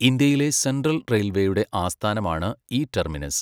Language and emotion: Malayalam, neutral